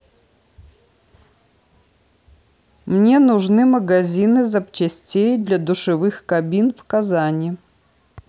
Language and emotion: Russian, neutral